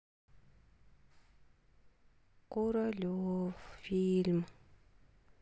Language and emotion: Russian, sad